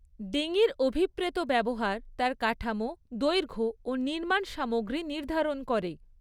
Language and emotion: Bengali, neutral